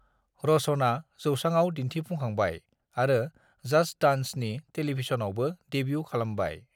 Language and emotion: Bodo, neutral